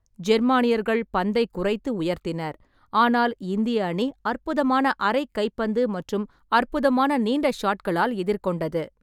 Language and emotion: Tamil, neutral